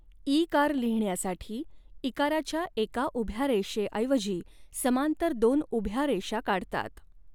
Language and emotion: Marathi, neutral